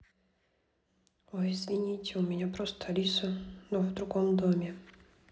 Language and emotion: Russian, sad